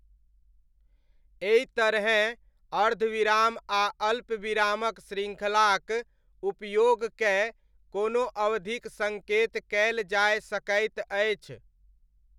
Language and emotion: Maithili, neutral